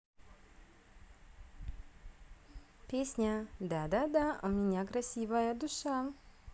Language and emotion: Russian, positive